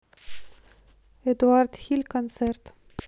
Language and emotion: Russian, neutral